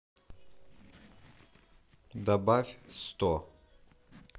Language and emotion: Russian, neutral